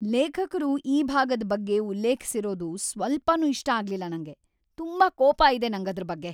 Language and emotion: Kannada, angry